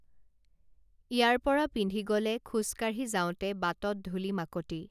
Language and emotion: Assamese, neutral